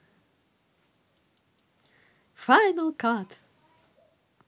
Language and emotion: Russian, positive